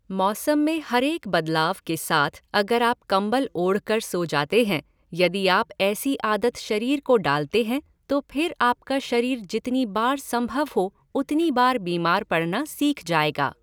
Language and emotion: Hindi, neutral